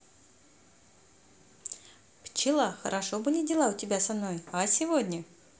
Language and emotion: Russian, positive